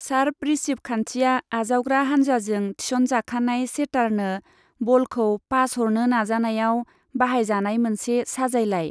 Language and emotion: Bodo, neutral